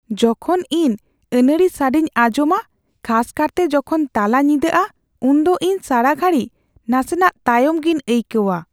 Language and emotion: Santali, fearful